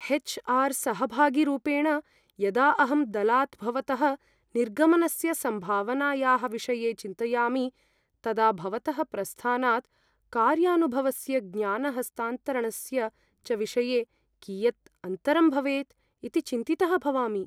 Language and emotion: Sanskrit, fearful